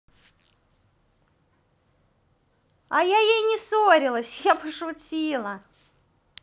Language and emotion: Russian, positive